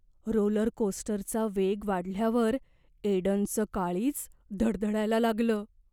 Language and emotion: Marathi, fearful